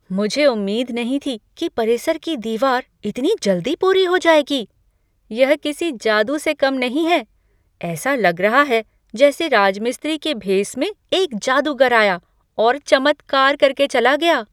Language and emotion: Hindi, surprised